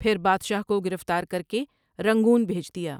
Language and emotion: Urdu, neutral